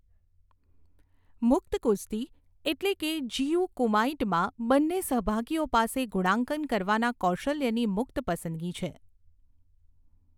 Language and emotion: Gujarati, neutral